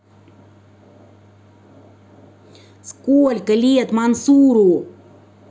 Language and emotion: Russian, angry